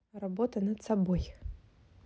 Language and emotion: Russian, neutral